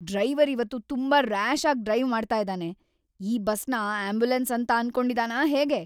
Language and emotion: Kannada, angry